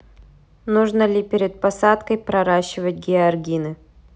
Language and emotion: Russian, neutral